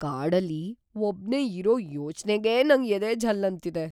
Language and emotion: Kannada, fearful